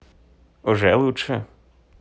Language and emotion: Russian, positive